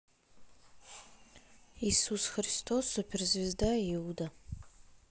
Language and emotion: Russian, neutral